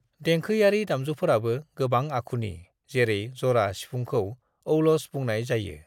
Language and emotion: Bodo, neutral